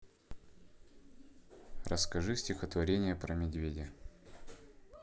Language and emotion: Russian, neutral